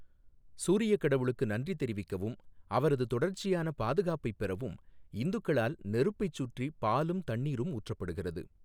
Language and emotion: Tamil, neutral